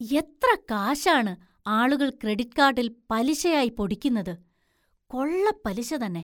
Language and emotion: Malayalam, surprised